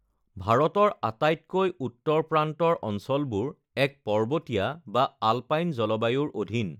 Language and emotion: Assamese, neutral